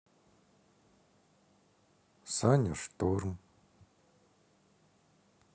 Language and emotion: Russian, sad